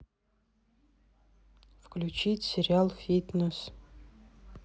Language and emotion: Russian, neutral